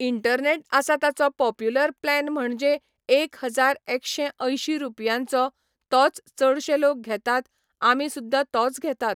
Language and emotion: Goan Konkani, neutral